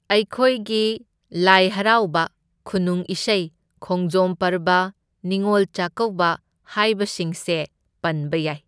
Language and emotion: Manipuri, neutral